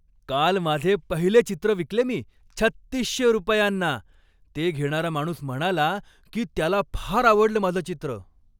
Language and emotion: Marathi, happy